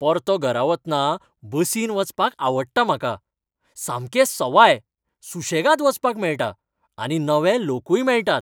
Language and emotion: Goan Konkani, happy